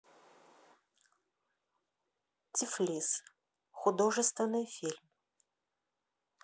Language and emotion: Russian, neutral